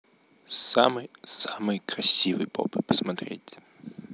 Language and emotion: Russian, neutral